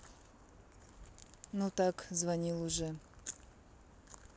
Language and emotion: Russian, neutral